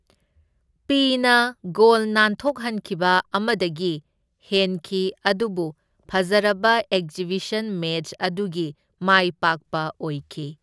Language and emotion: Manipuri, neutral